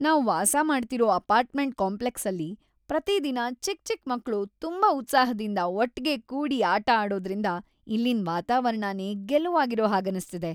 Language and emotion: Kannada, happy